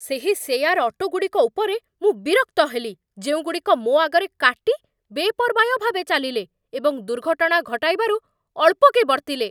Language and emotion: Odia, angry